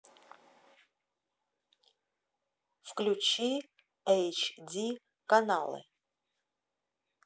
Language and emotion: Russian, neutral